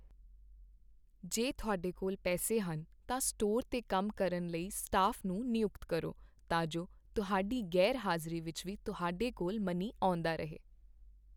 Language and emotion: Punjabi, neutral